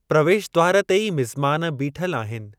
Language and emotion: Sindhi, neutral